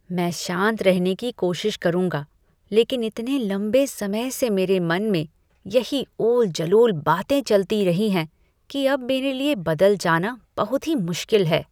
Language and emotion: Hindi, disgusted